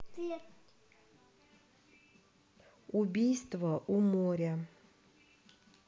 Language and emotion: Russian, neutral